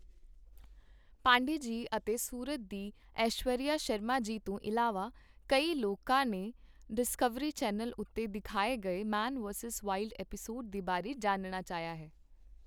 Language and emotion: Punjabi, neutral